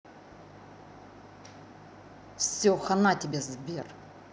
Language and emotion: Russian, angry